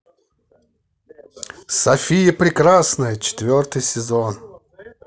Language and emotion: Russian, positive